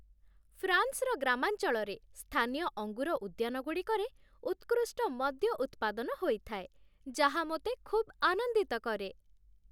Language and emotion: Odia, happy